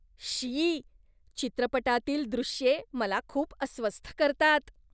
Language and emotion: Marathi, disgusted